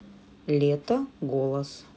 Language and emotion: Russian, neutral